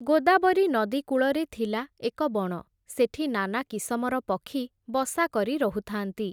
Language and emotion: Odia, neutral